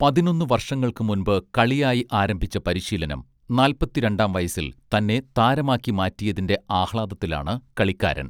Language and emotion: Malayalam, neutral